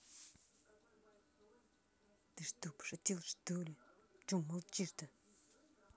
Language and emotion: Russian, angry